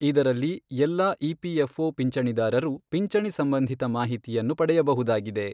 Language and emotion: Kannada, neutral